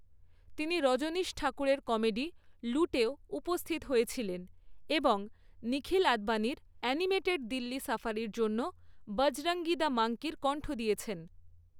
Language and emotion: Bengali, neutral